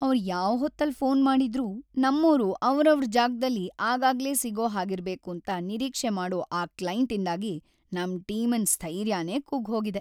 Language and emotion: Kannada, sad